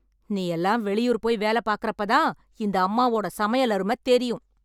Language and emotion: Tamil, angry